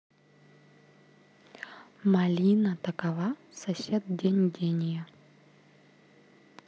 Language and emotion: Russian, neutral